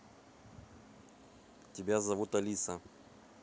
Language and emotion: Russian, neutral